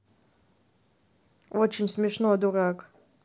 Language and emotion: Russian, neutral